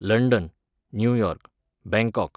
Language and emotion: Goan Konkani, neutral